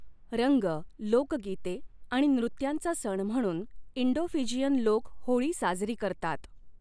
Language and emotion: Marathi, neutral